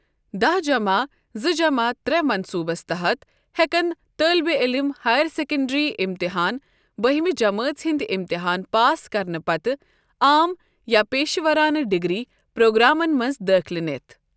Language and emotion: Kashmiri, neutral